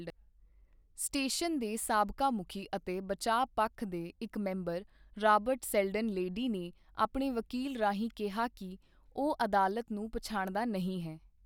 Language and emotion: Punjabi, neutral